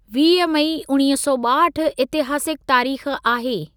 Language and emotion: Sindhi, neutral